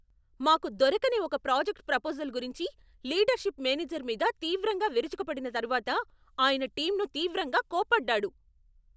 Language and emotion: Telugu, angry